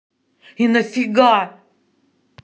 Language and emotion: Russian, angry